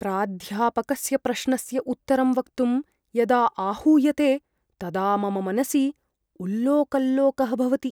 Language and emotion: Sanskrit, fearful